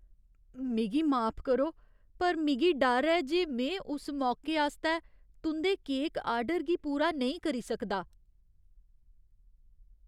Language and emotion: Dogri, fearful